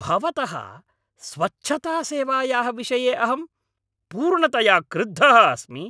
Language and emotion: Sanskrit, angry